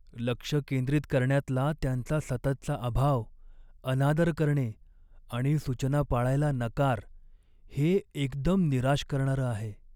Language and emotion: Marathi, sad